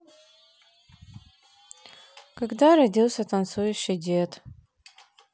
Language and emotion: Russian, sad